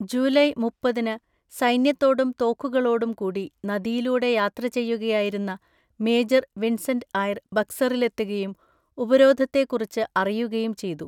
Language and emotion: Malayalam, neutral